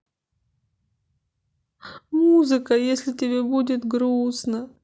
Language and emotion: Russian, sad